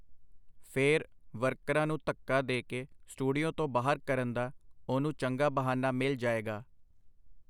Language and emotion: Punjabi, neutral